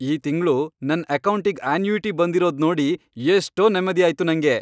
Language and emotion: Kannada, happy